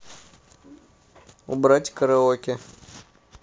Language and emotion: Russian, neutral